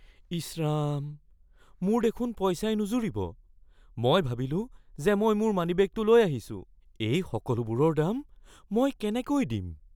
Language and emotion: Assamese, fearful